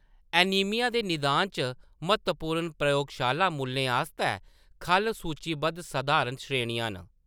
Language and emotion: Dogri, neutral